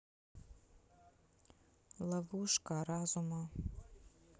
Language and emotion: Russian, neutral